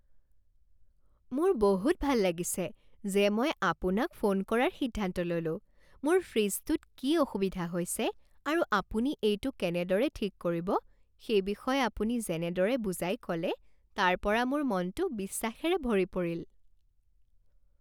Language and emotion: Assamese, happy